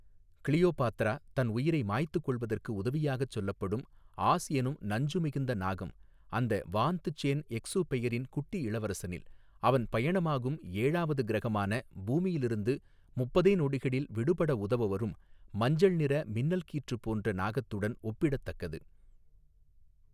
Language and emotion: Tamil, neutral